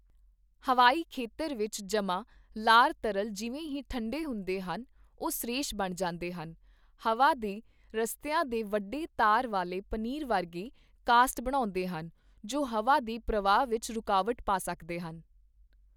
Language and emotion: Punjabi, neutral